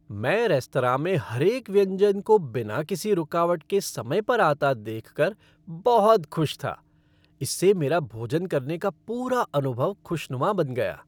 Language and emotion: Hindi, happy